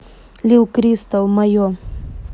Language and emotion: Russian, neutral